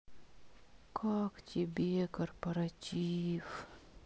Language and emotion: Russian, sad